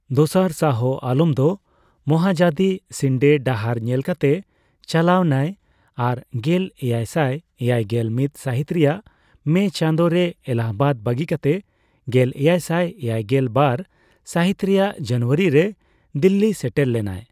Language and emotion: Santali, neutral